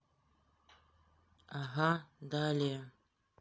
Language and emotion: Russian, neutral